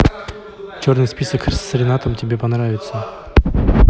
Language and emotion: Russian, neutral